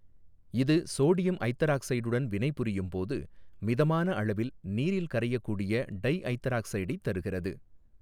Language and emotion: Tamil, neutral